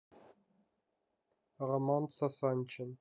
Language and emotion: Russian, neutral